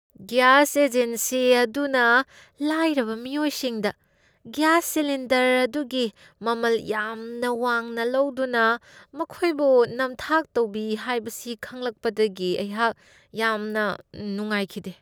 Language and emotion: Manipuri, disgusted